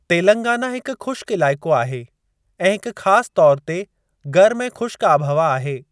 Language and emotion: Sindhi, neutral